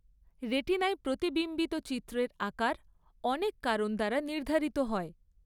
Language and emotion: Bengali, neutral